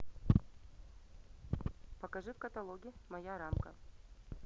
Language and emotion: Russian, neutral